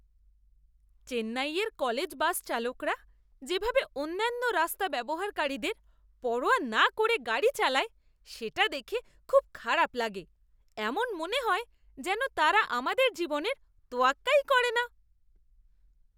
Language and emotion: Bengali, disgusted